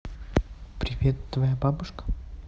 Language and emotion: Russian, neutral